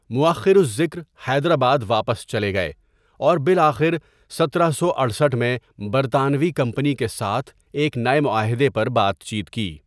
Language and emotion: Urdu, neutral